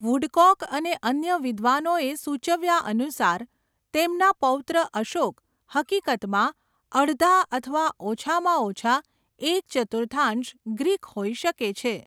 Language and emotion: Gujarati, neutral